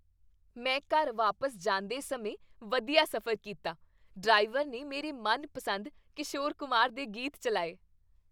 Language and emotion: Punjabi, happy